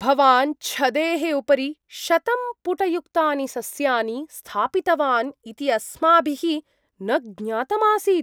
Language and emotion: Sanskrit, surprised